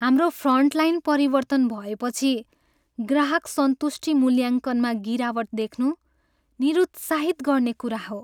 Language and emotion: Nepali, sad